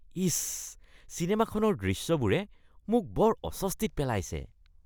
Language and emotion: Assamese, disgusted